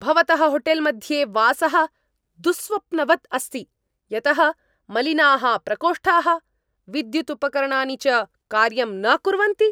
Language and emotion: Sanskrit, angry